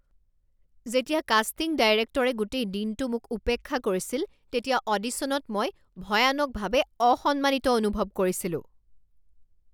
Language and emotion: Assamese, angry